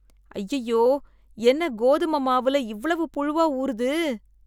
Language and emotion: Tamil, disgusted